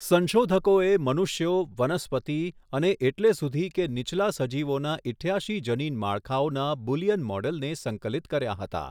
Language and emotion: Gujarati, neutral